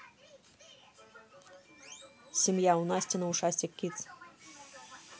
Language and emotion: Russian, neutral